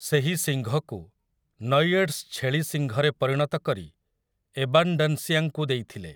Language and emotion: Odia, neutral